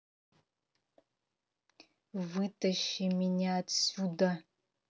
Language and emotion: Russian, angry